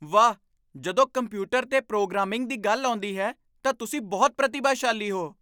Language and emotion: Punjabi, surprised